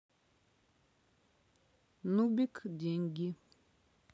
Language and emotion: Russian, neutral